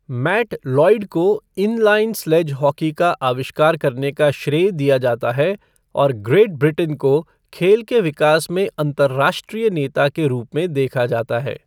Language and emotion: Hindi, neutral